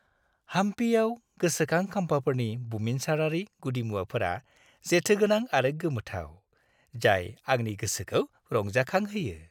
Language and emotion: Bodo, happy